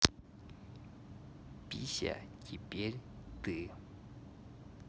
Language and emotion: Russian, neutral